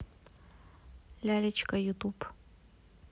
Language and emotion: Russian, neutral